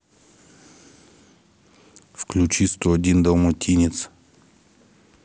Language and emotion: Russian, neutral